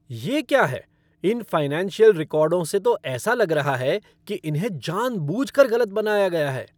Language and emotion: Hindi, angry